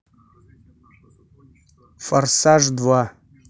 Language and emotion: Russian, neutral